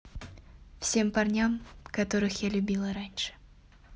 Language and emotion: Russian, sad